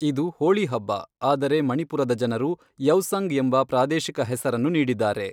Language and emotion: Kannada, neutral